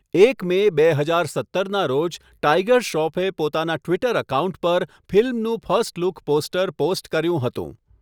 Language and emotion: Gujarati, neutral